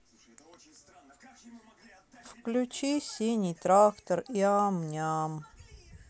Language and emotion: Russian, sad